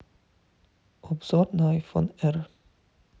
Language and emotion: Russian, neutral